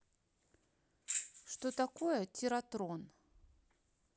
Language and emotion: Russian, neutral